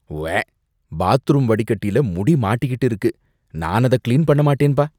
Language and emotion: Tamil, disgusted